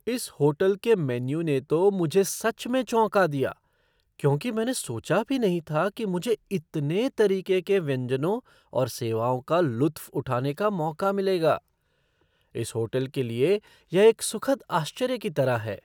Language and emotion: Hindi, surprised